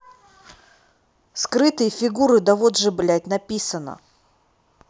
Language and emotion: Russian, neutral